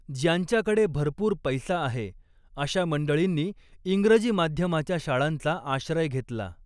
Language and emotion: Marathi, neutral